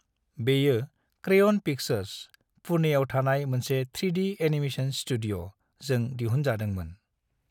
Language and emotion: Bodo, neutral